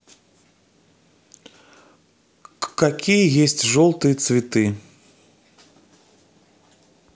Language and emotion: Russian, neutral